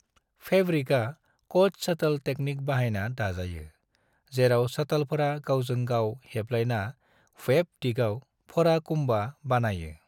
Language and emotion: Bodo, neutral